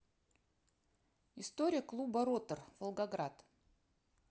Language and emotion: Russian, neutral